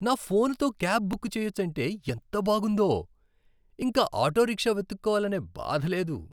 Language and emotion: Telugu, happy